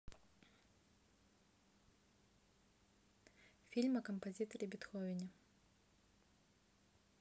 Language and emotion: Russian, neutral